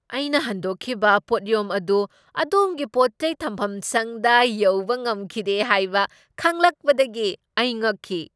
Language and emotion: Manipuri, surprised